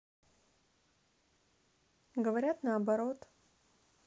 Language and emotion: Russian, neutral